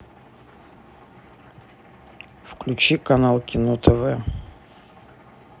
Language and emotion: Russian, neutral